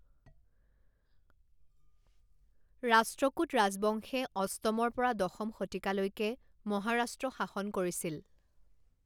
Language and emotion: Assamese, neutral